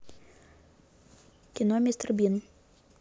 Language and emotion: Russian, neutral